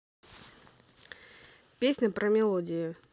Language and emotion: Russian, neutral